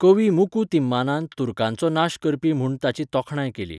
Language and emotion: Goan Konkani, neutral